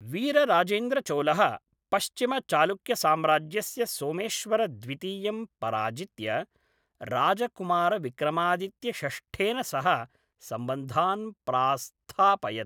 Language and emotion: Sanskrit, neutral